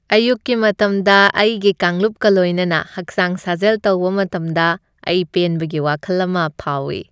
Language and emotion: Manipuri, happy